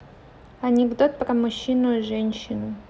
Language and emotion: Russian, neutral